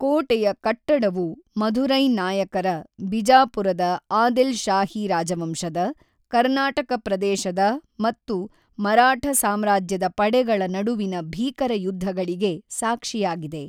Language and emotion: Kannada, neutral